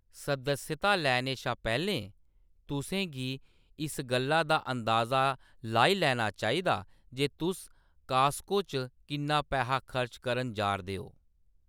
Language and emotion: Dogri, neutral